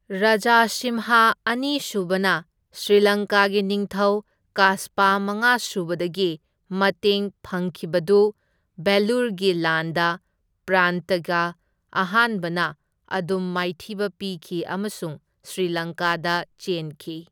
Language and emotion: Manipuri, neutral